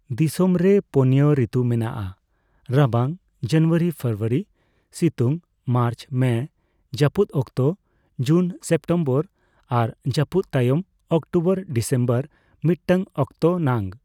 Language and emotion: Santali, neutral